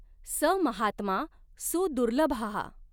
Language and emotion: Marathi, neutral